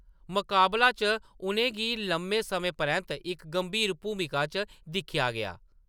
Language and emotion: Dogri, neutral